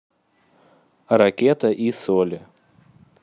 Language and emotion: Russian, neutral